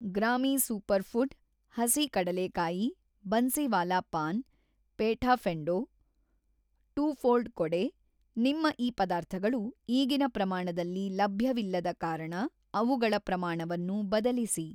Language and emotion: Kannada, neutral